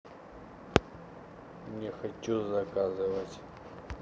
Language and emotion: Russian, neutral